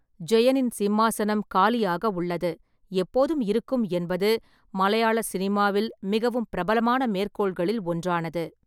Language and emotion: Tamil, neutral